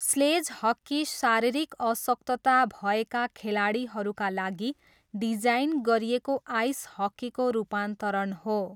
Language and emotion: Nepali, neutral